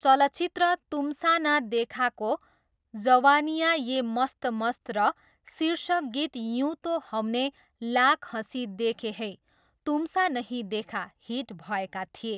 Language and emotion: Nepali, neutral